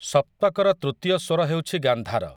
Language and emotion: Odia, neutral